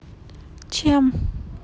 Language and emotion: Russian, sad